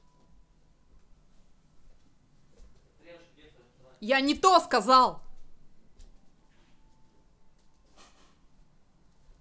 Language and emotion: Russian, angry